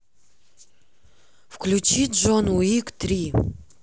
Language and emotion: Russian, neutral